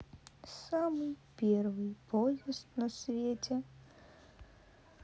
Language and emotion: Russian, sad